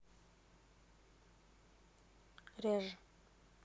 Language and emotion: Russian, neutral